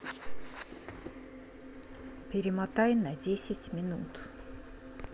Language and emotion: Russian, neutral